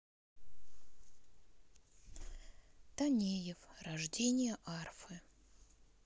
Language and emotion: Russian, sad